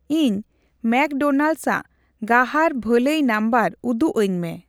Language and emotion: Santali, neutral